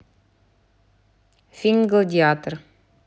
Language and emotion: Russian, neutral